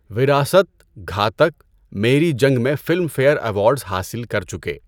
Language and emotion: Urdu, neutral